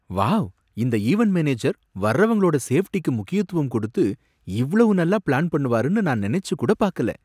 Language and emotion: Tamil, surprised